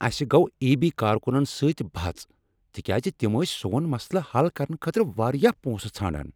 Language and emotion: Kashmiri, angry